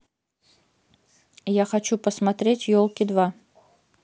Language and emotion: Russian, neutral